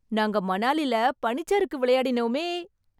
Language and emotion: Tamil, happy